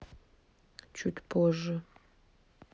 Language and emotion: Russian, neutral